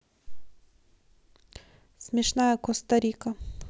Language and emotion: Russian, neutral